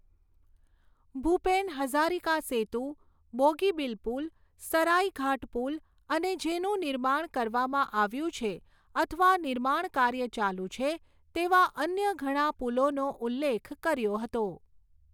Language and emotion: Gujarati, neutral